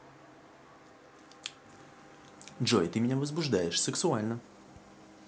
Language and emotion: Russian, positive